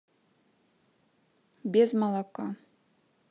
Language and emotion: Russian, neutral